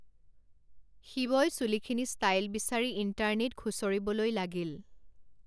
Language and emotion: Assamese, neutral